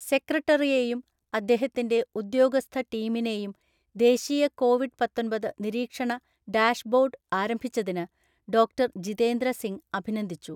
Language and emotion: Malayalam, neutral